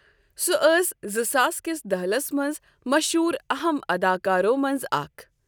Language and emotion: Kashmiri, neutral